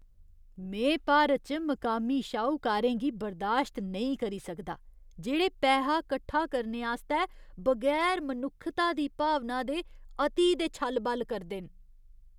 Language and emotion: Dogri, disgusted